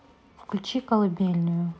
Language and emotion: Russian, neutral